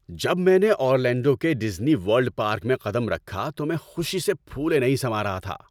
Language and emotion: Urdu, happy